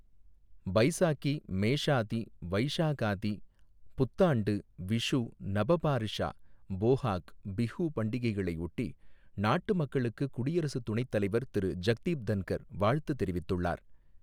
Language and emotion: Tamil, neutral